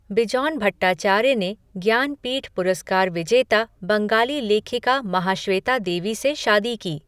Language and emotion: Hindi, neutral